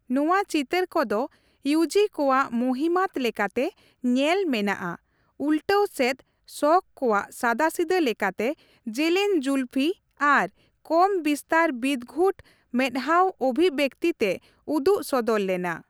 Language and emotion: Santali, neutral